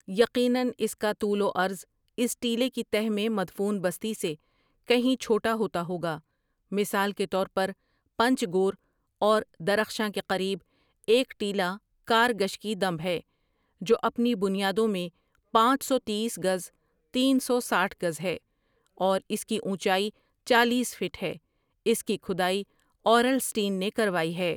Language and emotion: Urdu, neutral